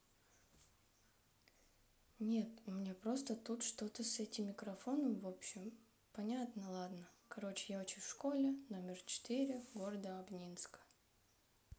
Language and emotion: Russian, sad